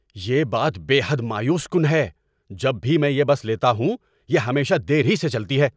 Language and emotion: Urdu, angry